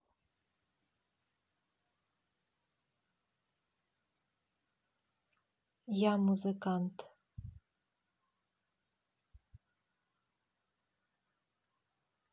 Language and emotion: Russian, neutral